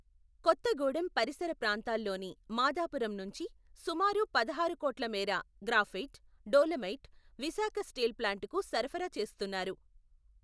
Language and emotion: Telugu, neutral